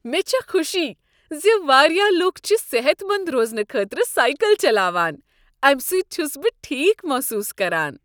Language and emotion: Kashmiri, happy